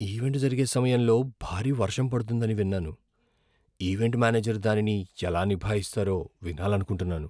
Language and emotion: Telugu, fearful